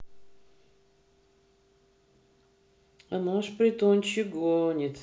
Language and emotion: Russian, neutral